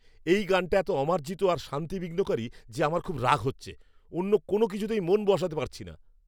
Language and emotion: Bengali, angry